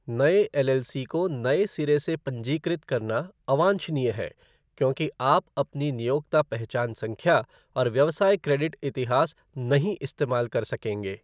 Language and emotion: Hindi, neutral